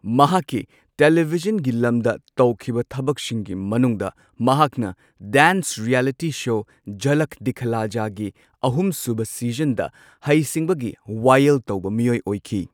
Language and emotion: Manipuri, neutral